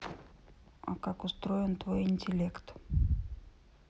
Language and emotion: Russian, neutral